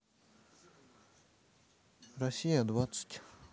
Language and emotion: Russian, neutral